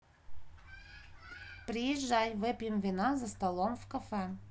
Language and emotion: Russian, neutral